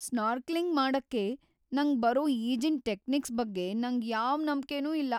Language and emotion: Kannada, fearful